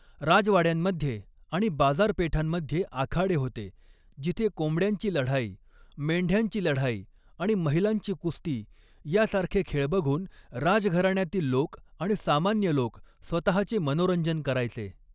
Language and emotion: Marathi, neutral